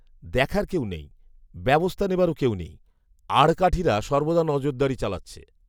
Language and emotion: Bengali, neutral